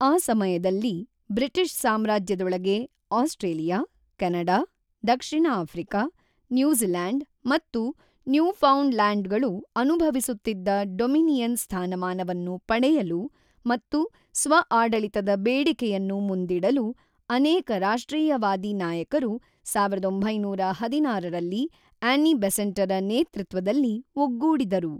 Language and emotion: Kannada, neutral